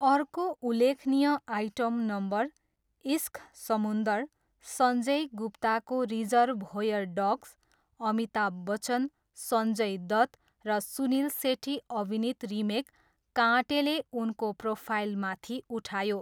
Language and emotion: Nepali, neutral